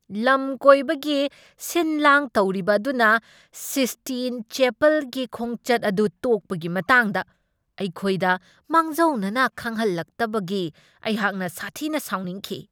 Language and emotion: Manipuri, angry